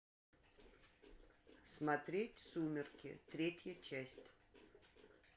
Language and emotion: Russian, neutral